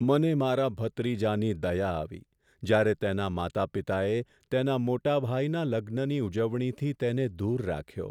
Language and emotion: Gujarati, sad